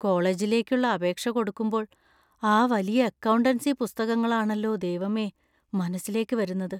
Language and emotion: Malayalam, fearful